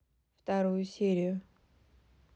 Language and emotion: Russian, neutral